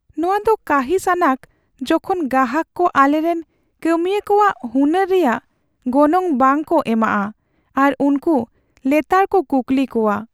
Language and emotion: Santali, sad